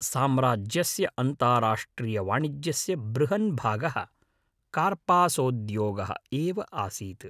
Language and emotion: Sanskrit, neutral